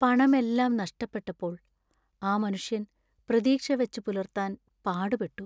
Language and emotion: Malayalam, sad